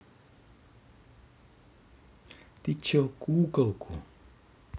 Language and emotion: Russian, angry